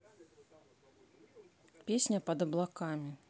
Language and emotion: Russian, neutral